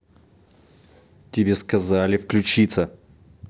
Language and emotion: Russian, angry